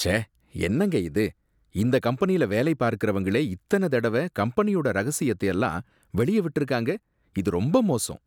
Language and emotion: Tamil, disgusted